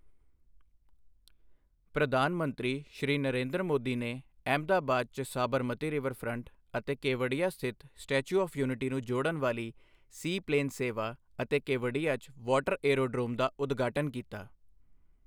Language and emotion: Punjabi, neutral